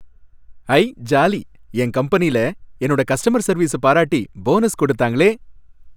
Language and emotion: Tamil, happy